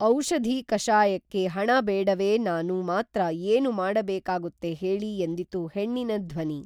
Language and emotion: Kannada, neutral